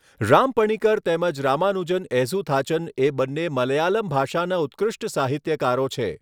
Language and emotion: Gujarati, neutral